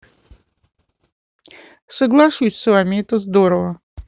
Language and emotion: Russian, neutral